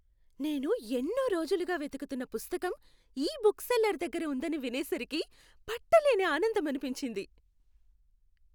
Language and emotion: Telugu, happy